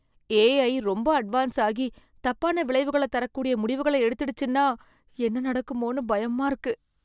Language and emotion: Tamil, fearful